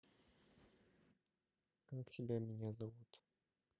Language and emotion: Russian, neutral